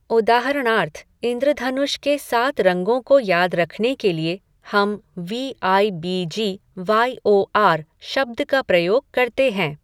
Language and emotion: Hindi, neutral